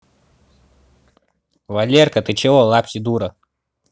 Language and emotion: Russian, angry